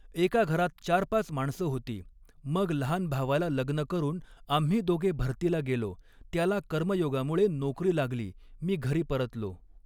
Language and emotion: Marathi, neutral